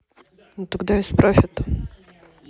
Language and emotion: Russian, neutral